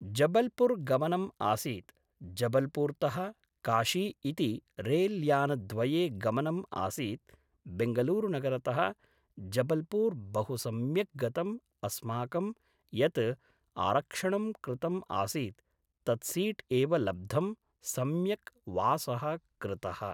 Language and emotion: Sanskrit, neutral